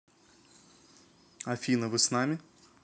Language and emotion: Russian, neutral